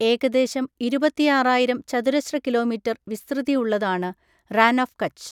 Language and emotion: Malayalam, neutral